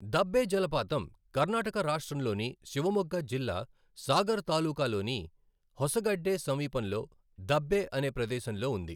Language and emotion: Telugu, neutral